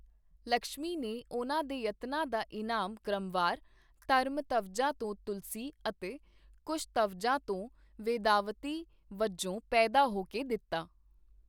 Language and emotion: Punjabi, neutral